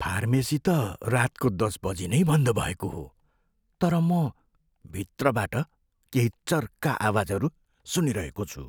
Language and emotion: Nepali, fearful